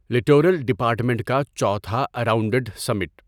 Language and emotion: Urdu, neutral